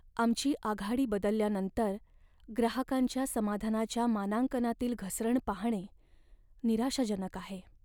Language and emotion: Marathi, sad